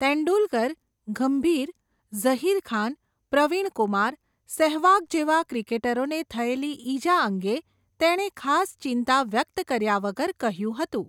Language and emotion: Gujarati, neutral